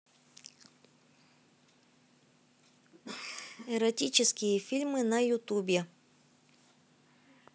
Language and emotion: Russian, neutral